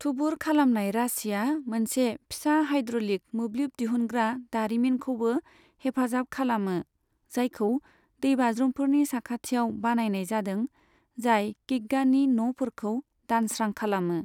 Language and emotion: Bodo, neutral